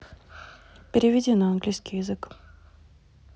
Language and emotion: Russian, neutral